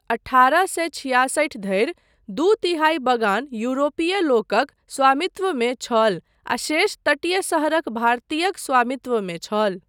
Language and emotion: Maithili, neutral